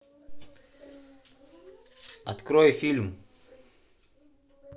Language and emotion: Russian, neutral